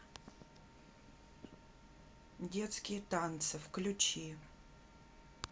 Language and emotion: Russian, neutral